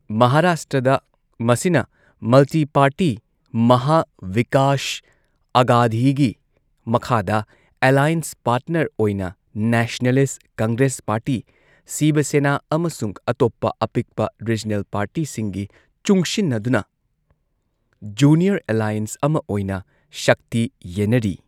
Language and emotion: Manipuri, neutral